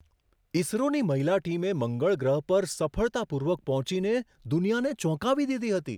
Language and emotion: Gujarati, surprised